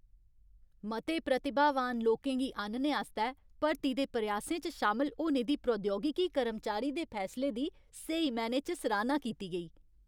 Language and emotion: Dogri, happy